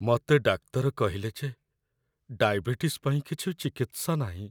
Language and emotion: Odia, sad